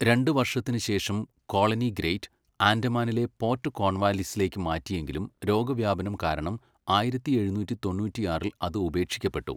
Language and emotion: Malayalam, neutral